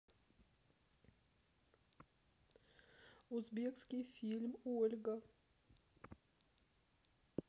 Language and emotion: Russian, sad